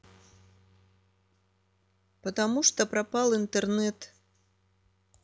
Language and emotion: Russian, neutral